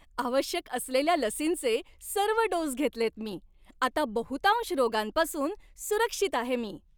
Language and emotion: Marathi, happy